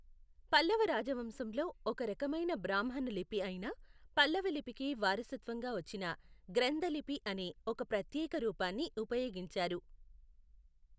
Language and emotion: Telugu, neutral